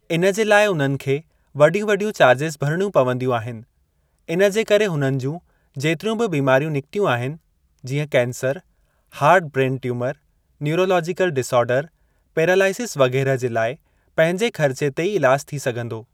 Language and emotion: Sindhi, neutral